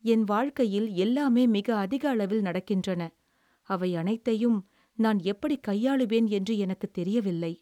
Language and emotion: Tamil, sad